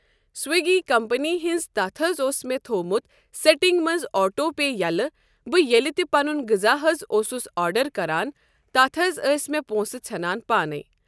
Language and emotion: Kashmiri, neutral